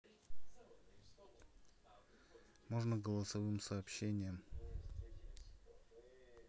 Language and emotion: Russian, neutral